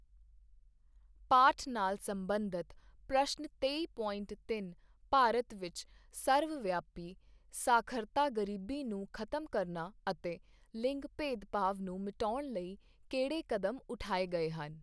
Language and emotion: Punjabi, neutral